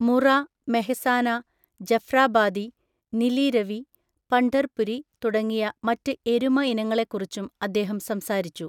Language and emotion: Malayalam, neutral